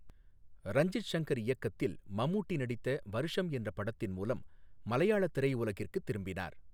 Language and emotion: Tamil, neutral